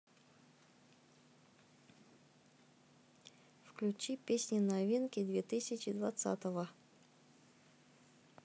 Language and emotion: Russian, neutral